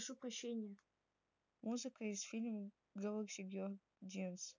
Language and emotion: Russian, neutral